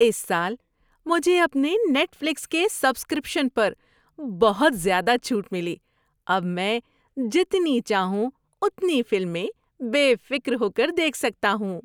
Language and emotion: Urdu, happy